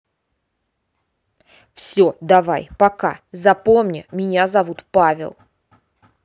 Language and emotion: Russian, angry